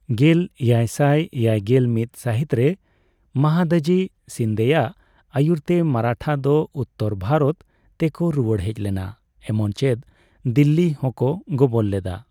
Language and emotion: Santali, neutral